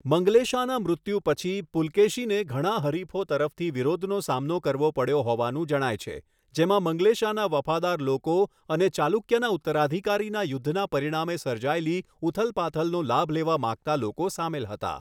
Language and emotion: Gujarati, neutral